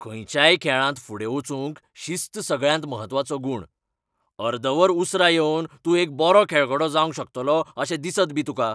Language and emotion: Goan Konkani, angry